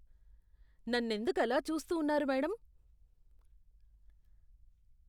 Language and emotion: Telugu, disgusted